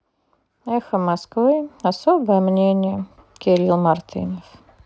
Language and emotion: Russian, sad